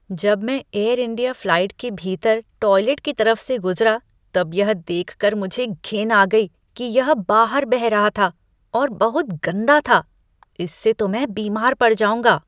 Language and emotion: Hindi, disgusted